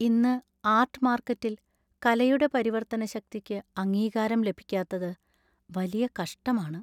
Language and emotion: Malayalam, sad